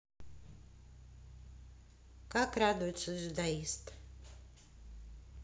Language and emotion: Russian, neutral